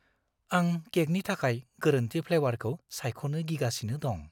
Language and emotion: Bodo, fearful